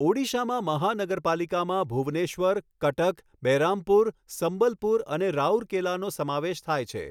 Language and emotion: Gujarati, neutral